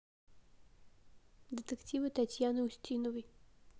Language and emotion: Russian, neutral